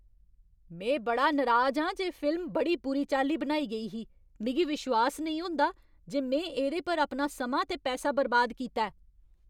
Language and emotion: Dogri, angry